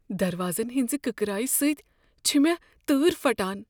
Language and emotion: Kashmiri, fearful